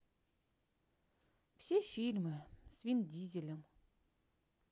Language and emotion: Russian, sad